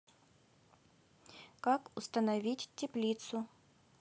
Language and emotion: Russian, neutral